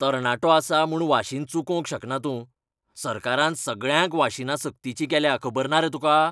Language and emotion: Goan Konkani, angry